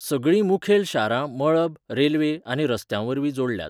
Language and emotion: Goan Konkani, neutral